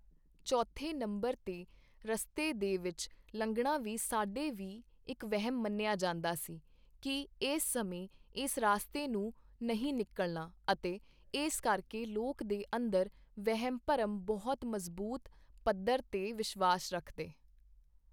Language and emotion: Punjabi, neutral